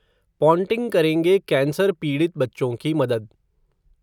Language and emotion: Hindi, neutral